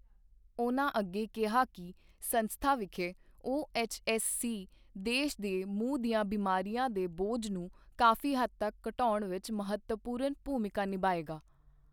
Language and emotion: Punjabi, neutral